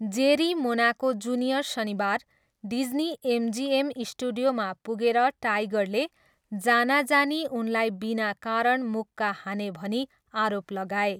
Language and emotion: Nepali, neutral